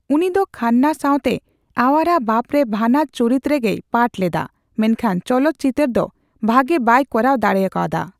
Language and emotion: Santali, neutral